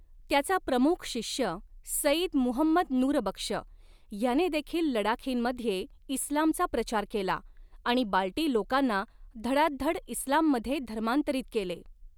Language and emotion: Marathi, neutral